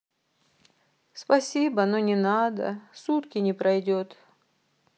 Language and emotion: Russian, sad